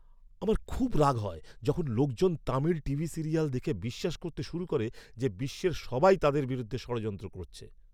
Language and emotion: Bengali, angry